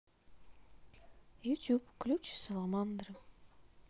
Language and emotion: Russian, neutral